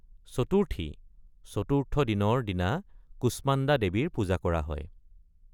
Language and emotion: Assamese, neutral